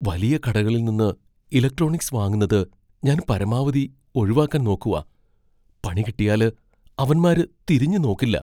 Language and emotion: Malayalam, fearful